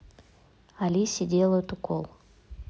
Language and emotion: Russian, neutral